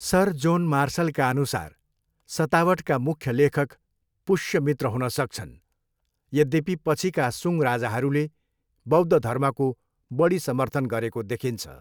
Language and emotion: Nepali, neutral